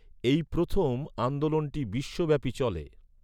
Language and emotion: Bengali, neutral